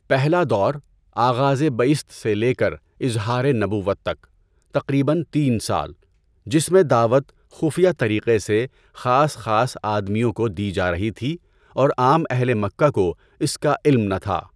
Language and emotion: Urdu, neutral